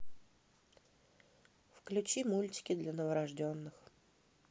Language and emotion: Russian, neutral